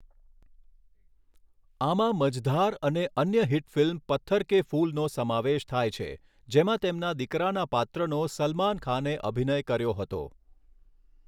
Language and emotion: Gujarati, neutral